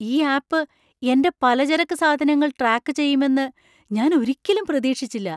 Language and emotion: Malayalam, surprised